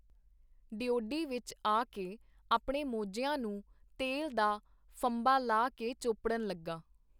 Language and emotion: Punjabi, neutral